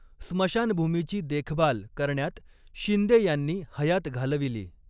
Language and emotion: Marathi, neutral